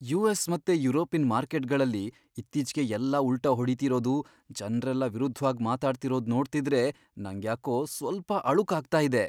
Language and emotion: Kannada, fearful